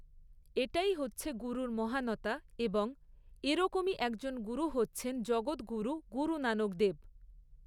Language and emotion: Bengali, neutral